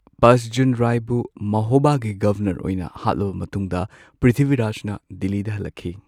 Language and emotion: Manipuri, neutral